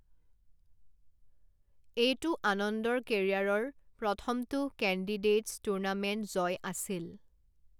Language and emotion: Assamese, neutral